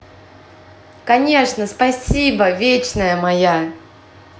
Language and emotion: Russian, positive